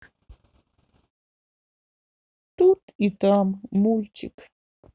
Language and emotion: Russian, sad